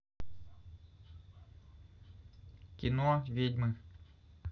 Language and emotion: Russian, neutral